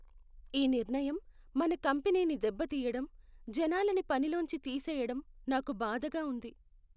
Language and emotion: Telugu, sad